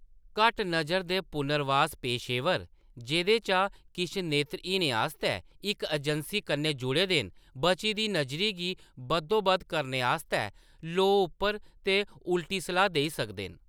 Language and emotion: Dogri, neutral